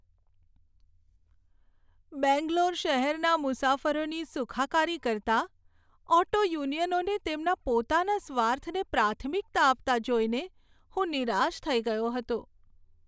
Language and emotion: Gujarati, sad